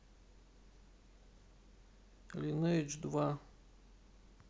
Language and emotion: Russian, sad